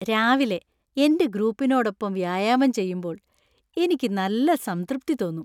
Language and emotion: Malayalam, happy